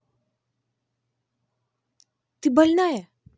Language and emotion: Russian, angry